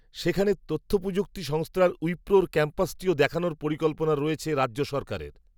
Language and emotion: Bengali, neutral